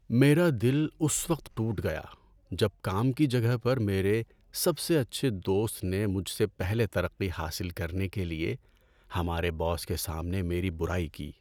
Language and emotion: Urdu, sad